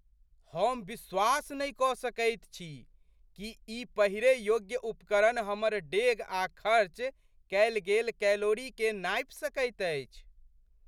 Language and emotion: Maithili, surprised